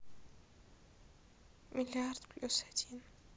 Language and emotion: Russian, sad